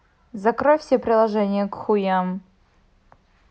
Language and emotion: Russian, neutral